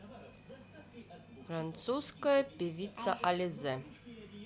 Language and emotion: Russian, neutral